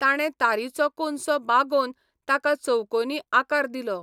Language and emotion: Goan Konkani, neutral